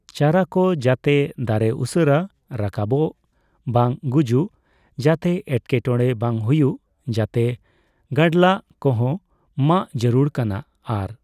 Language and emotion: Santali, neutral